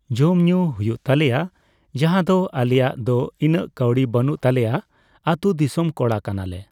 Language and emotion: Santali, neutral